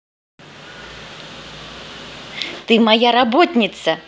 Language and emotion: Russian, positive